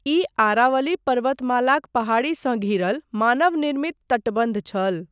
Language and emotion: Maithili, neutral